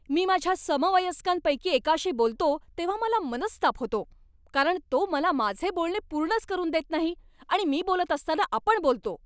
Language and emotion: Marathi, angry